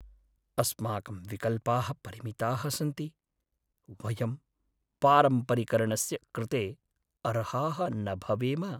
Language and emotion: Sanskrit, sad